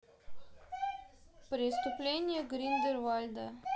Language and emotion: Russian, neutral